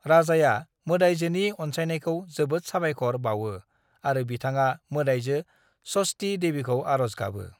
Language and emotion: Bodo, neutral